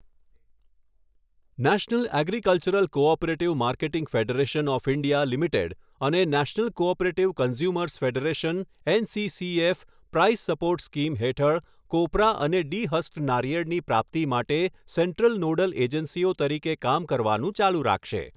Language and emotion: Gujarati, neutral